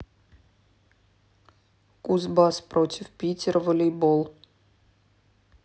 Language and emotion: Russian, neutral